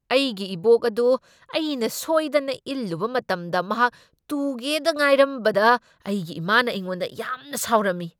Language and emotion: Manipuri, angry